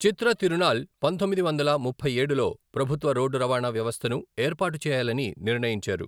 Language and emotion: Telugu, neutral